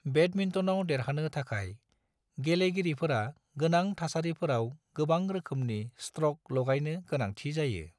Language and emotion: Bodo, neutral